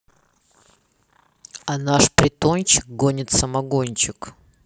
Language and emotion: Russian, neutral